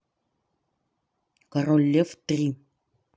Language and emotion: Russian, neutral